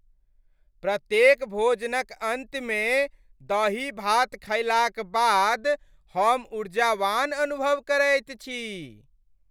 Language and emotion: Maithili, happy